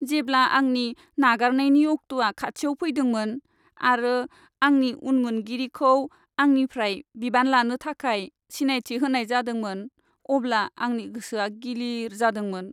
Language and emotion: Bodo, sad